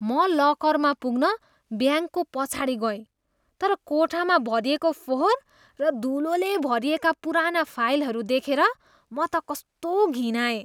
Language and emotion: Nepali, disgusted